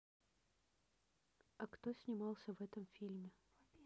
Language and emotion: Russian, neutral